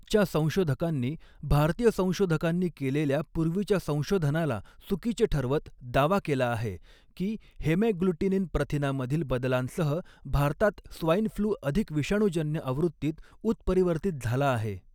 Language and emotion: Marathi, neutral